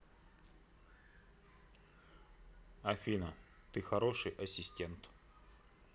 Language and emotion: Russian, neutral